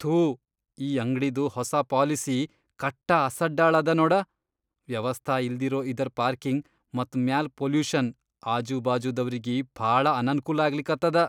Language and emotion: Kannada, disgusted